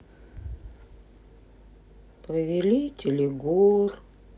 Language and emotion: Russian, sad